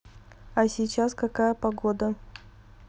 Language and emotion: Russian, neutral